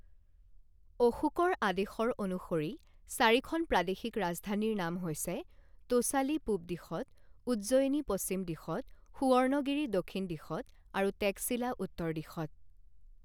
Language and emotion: Assamese, neutral